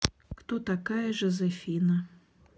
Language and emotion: Russian, neutral